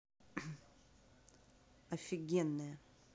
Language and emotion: Russian, neutral